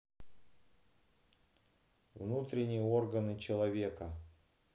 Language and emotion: Russian, neutral